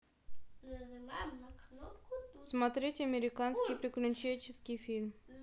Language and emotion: Russian, neutral